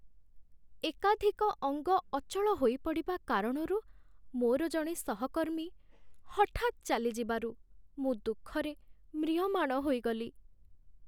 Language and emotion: Odia, sad